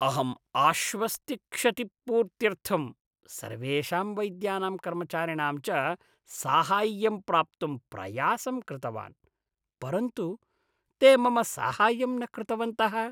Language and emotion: Sanskrit, disgusted